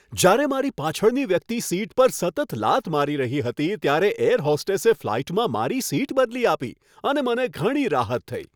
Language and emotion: Gujarati, happy